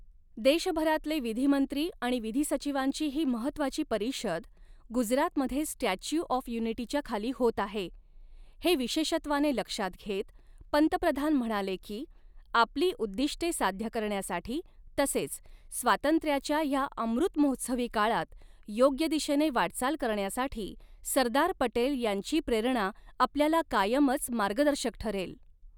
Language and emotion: Marathi, neutral